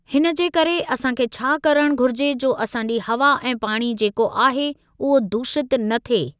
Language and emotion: Sindhi, neutral